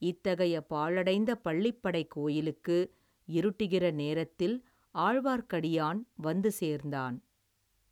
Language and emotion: Tamil, neutral